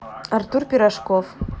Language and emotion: Russian, neutral